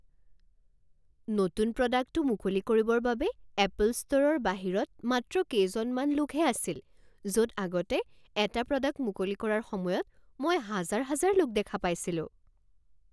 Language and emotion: Assamese, surprised